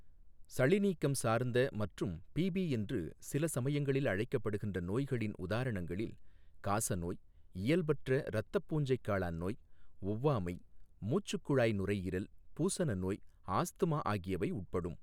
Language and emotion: Tamil, neutral